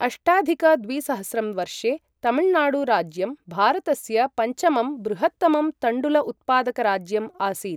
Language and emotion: Sanskrit, neutral